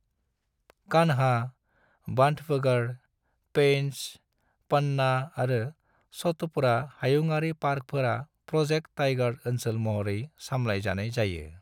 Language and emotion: Bodo, neutral